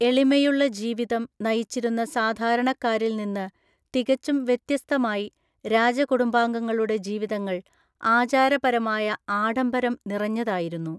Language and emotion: Malayalam, neutral